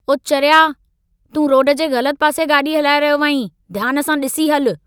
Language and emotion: Sindhi, angry